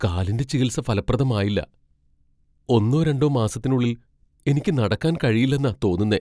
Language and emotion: Malayalam, fearful